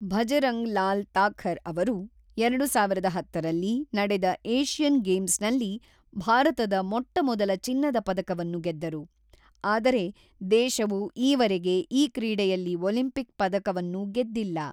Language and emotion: Kannada, neutral